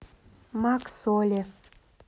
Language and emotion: Russian, neutral